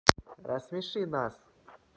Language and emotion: Russian, neutral